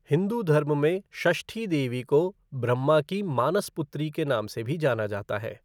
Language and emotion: Hindi, neutral